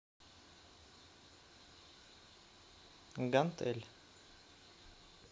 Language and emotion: Russian, neutral